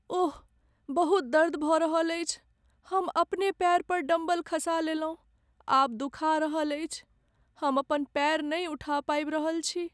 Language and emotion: Maithili, sad